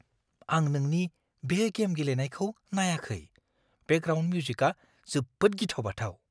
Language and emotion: Bodo, fearful